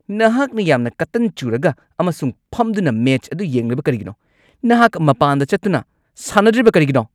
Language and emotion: Manipuri, angry